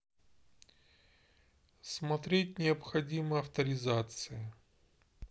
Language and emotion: Russian, neutral